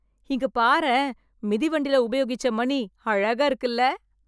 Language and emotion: Tamil, surprised